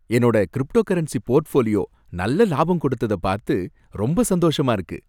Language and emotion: Tamil, happy